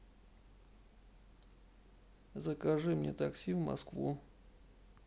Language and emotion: Russian, sad